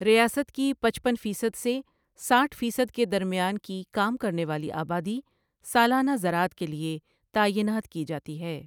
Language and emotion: Urdu, neutral